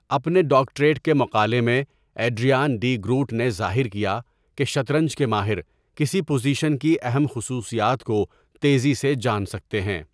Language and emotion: Urdu, neutral